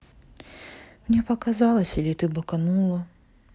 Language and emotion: Russian, sad